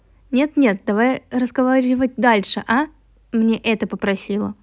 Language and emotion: Russian, neutral